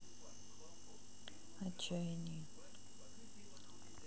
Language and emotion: Russian, sad